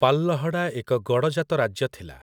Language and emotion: Odia, neutral